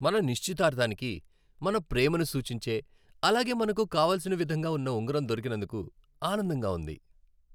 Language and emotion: Telugu, happy